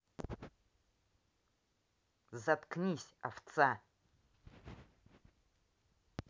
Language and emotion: Russian, angry